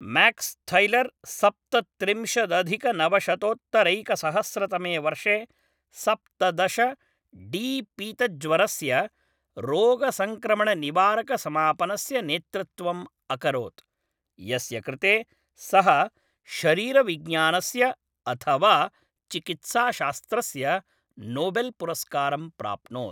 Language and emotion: Sanskrit, neutral